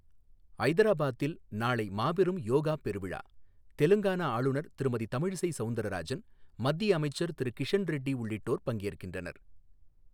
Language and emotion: Tamil, neutral